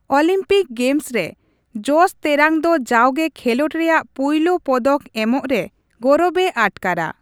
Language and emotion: Santali, neutral